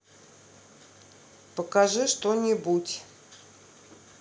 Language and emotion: Russian, neutral